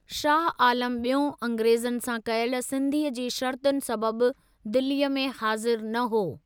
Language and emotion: Sindhi, neutral